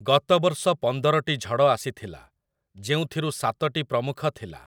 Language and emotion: Odia, neutral